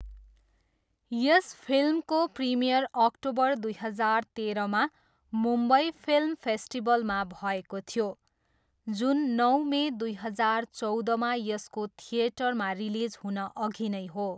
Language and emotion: Nepali, neutral